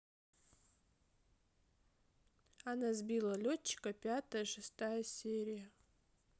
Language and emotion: Russian, neutral